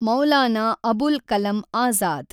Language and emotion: Kannada, neutral